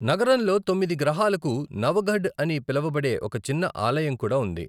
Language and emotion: Telugu, neutral